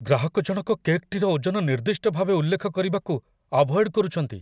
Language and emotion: Odia, fearful